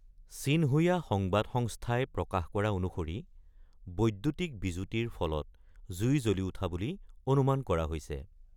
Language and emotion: Assamese, neutral